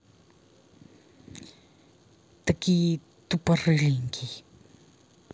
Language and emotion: Russian, angry